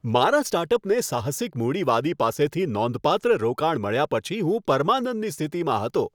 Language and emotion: Gujarati, happy